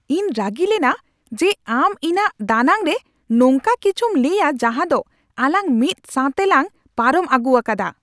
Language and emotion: Santali, angry